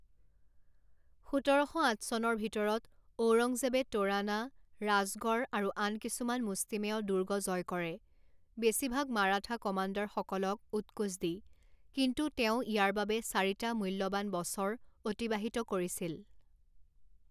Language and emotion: Assamese, neutral